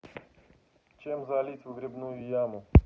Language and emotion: Russian, neutral